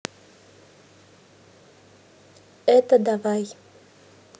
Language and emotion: Russian, neutral